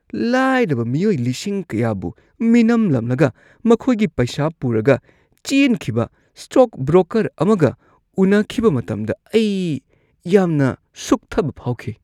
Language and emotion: Manipuri, disgusted